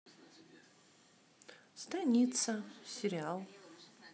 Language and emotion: Russian, neutral